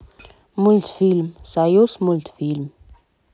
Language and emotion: Russian, neutral